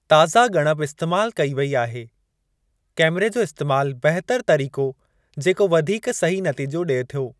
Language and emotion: Sindhi, neutral